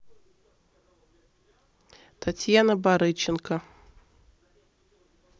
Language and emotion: Russian, neutral